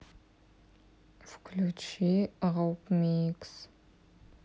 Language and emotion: Russian, neutral